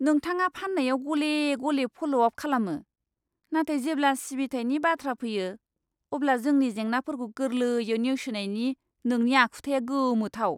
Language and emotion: Bodo, disgusted